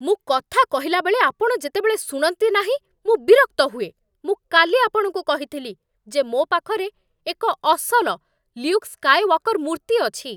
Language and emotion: Odia, angry